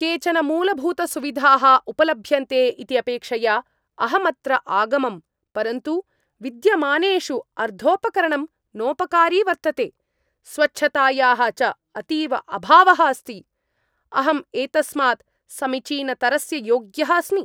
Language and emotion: Sanskrit, angry